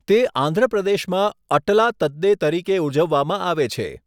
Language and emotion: Gujarati, neutral